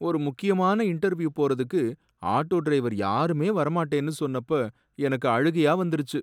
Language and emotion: Tamil, sad